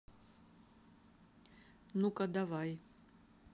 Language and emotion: Russian, neutral